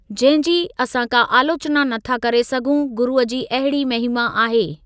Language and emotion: Sindhi, neutral